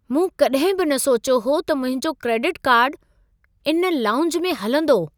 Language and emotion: Sindhi, surprised